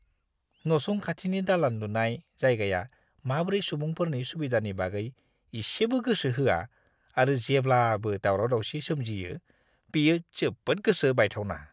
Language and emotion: Bodo, disgusted